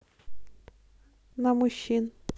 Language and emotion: Russian, neutral